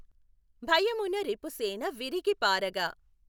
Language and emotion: Telugu, neutral